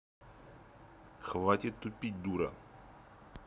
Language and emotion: Russian, angry